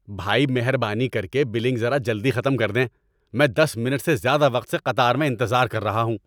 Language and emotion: Urdu, angry